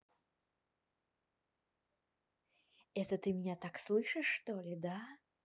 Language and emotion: Russian, neutral